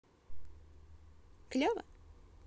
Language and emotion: Russian, positive